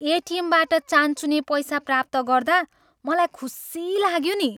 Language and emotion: Nepali, happy